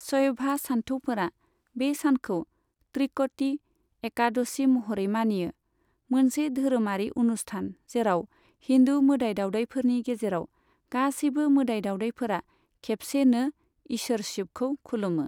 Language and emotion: Bodo, neutral